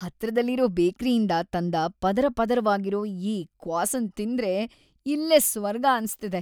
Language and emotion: Kannada, happy